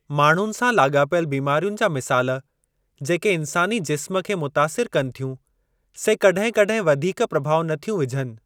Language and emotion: Sindhi, neutral